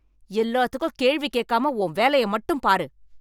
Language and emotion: Tamil, angry